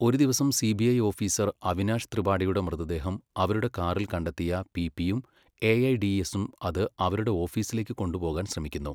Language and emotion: Malayalam, neutral